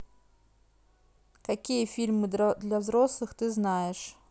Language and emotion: Russian, neutral